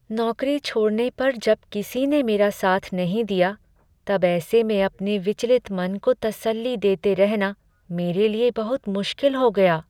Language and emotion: Hindi, sad